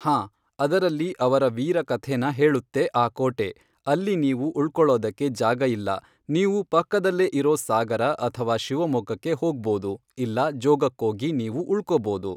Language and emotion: Kannada, neutral